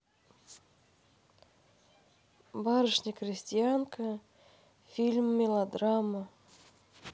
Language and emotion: Russian, neutral